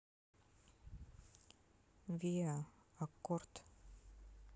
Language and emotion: Russian, neutral